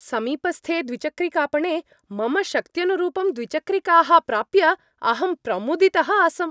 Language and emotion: Sanskrit, happy